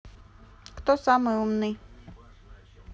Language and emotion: Russian, neutral